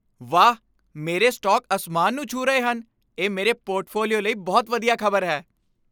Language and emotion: Punjabi, happy